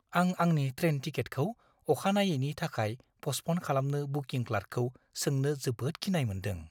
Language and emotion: Bodo, fearful